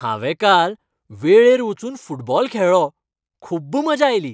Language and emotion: Goan Konkani, happy